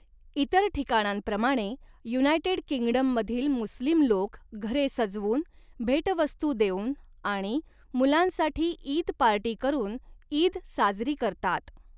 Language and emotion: Marathi, neutral